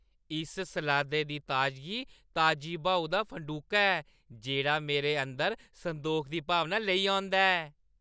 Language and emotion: Dogri, happy